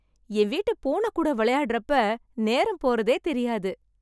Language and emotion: Tamil, happy